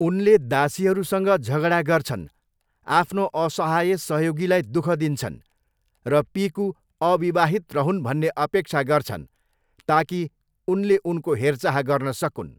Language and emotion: Nepali, neutral